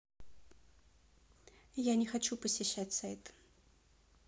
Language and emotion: Russian, neutral